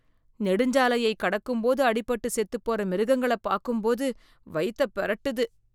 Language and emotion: Tamil, disgusted